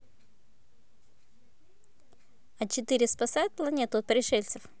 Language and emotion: Russian, neutral